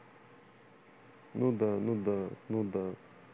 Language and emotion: Russian, neutral